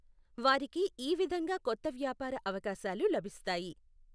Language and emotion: Telugu, neutral